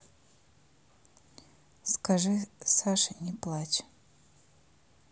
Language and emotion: Russian, neutral